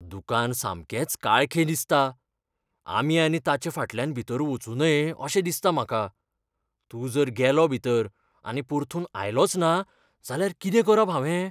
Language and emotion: Goan Konkani, fearful